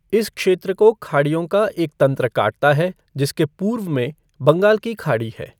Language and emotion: Hindi, neutral